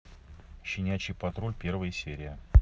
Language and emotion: Russian, neutral